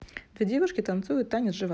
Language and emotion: Russian, neutral